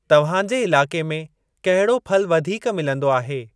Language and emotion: Sindhi, neutral